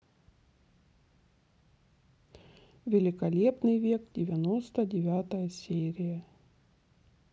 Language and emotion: Russian, neutral